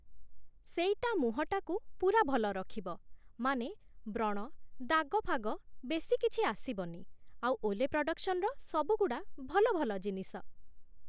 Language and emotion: Odia, neutral